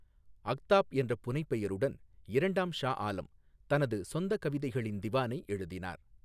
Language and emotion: Tamil, neutral